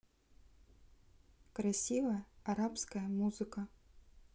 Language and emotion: Russian, neutral